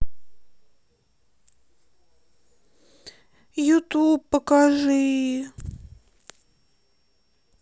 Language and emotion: Russian, sad